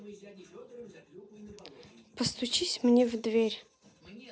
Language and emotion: Russian, neutral